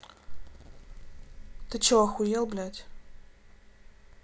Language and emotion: Russian, angry